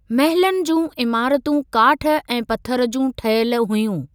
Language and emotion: Sindhi, neutral